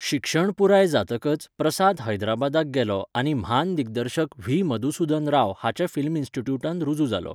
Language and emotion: Goan Konkani, neutral